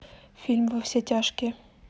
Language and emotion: Russian, neutral